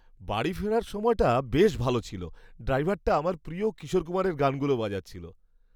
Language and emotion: Bengali, happy